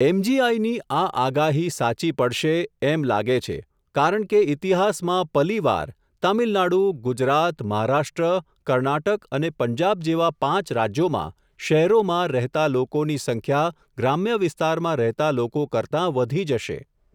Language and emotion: Gujarati, neutral